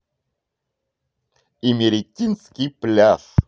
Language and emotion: Russian, positive